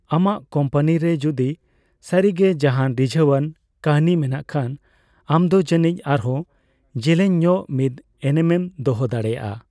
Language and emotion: Santali, neutral